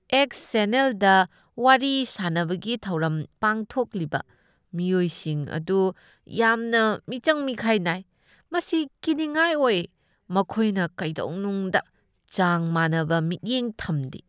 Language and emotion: Manipuri, disgusted